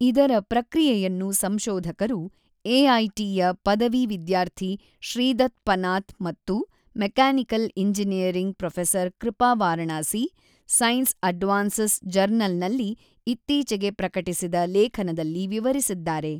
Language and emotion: Kannada, neutral